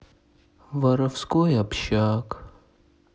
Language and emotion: Russian, sad